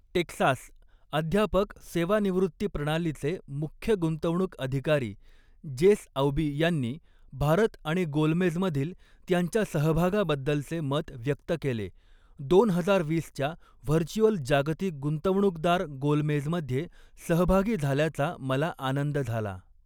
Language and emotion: Marathi, neutral